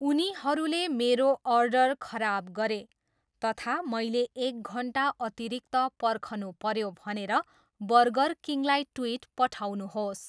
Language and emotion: Nepali, neutral